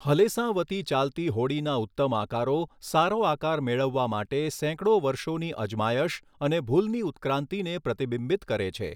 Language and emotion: Gujarati, neutral